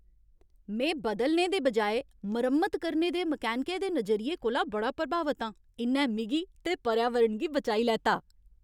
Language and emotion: Dogri, happy